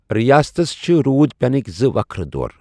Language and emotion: Kashmiri, neutral